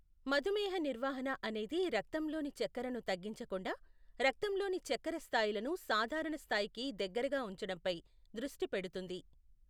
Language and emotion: Telugu, neutral